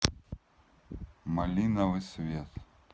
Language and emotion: Russian, neutral